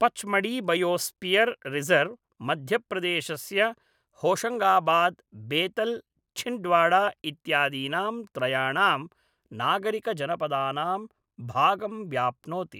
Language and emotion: Sanskrit, neutral